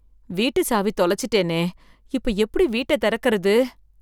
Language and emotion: Tamil, fearful